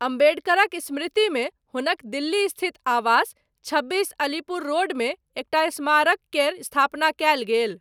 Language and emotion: Maithili, neutral